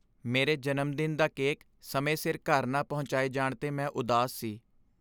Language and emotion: Punjabi, sad